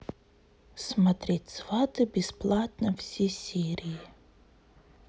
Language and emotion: Russian, neutral